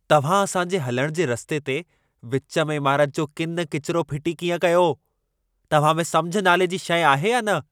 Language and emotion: Sindhi, angry